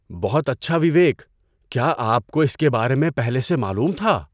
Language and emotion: Urdu, surprised